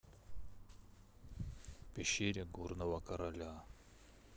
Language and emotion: Russian, neutral